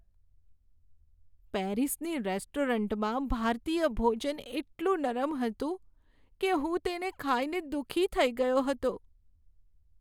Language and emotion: Gujarati, sad